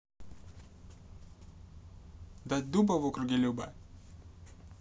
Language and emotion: Russian, neutral